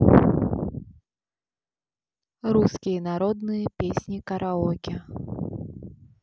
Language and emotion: Russian, neutral